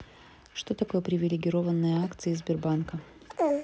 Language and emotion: Russian, neutral